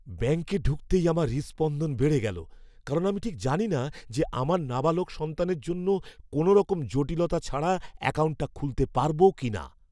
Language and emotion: Bengali, fearful